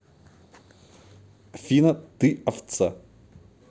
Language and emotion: Russian, angry